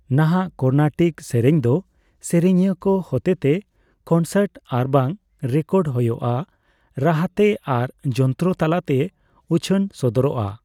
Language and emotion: Santali, neutral